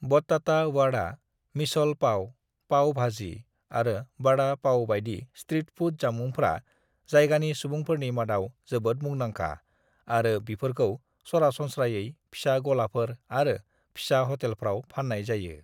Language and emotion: Bodo, neutral